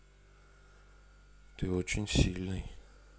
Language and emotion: Russian, neutral